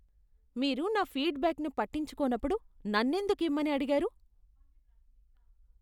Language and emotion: Telugu, disgusted